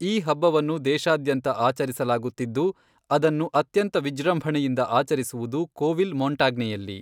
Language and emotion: Kannada, neutral